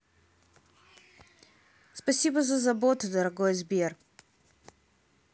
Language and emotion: Russian, positive